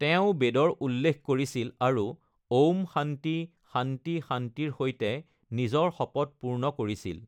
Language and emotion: Assamese, neutral